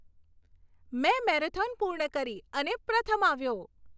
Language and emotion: Gujarati, happy